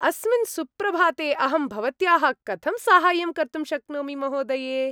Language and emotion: Sanskrit, happy